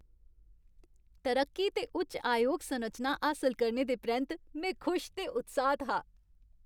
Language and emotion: Dogri, happy